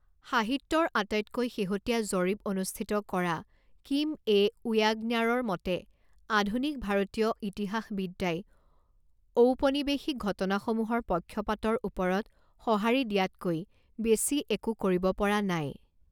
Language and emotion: Assamese, neutral